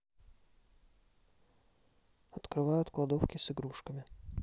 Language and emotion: Russian, neutral